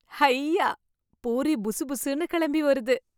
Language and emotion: Tamil, happy